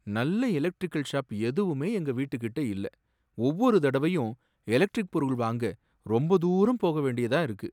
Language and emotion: Tamil, sad